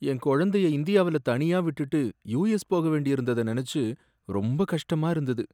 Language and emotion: Tamil, sad